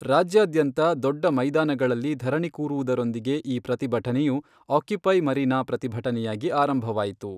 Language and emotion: Kannada, neutral